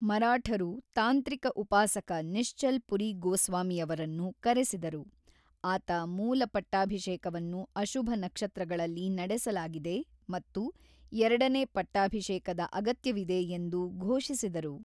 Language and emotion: Kannada, neutral